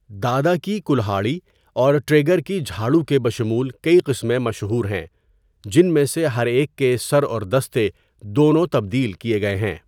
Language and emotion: Urdu, neutral